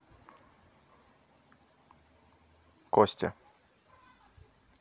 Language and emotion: Russian, neutral